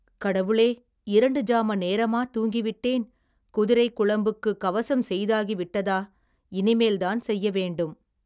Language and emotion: Tamil, neutral